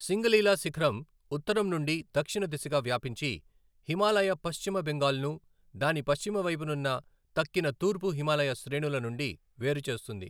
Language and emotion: Telugu, neutral